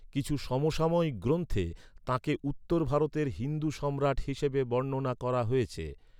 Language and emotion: Bengali, neutral